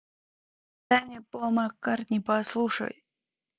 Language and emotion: Russian, neutral